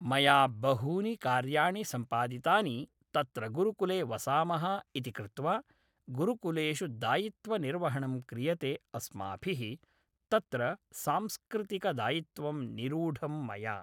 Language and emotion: Sanskrit, neutral